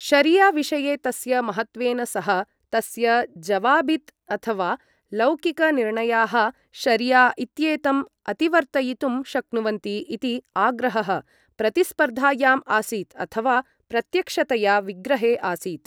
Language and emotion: Sanskrit, neutral